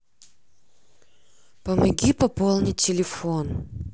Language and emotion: Russian, neutral